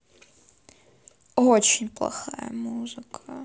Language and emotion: Russian, sad